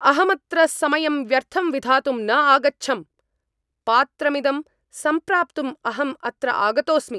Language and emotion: Sanskrit, angry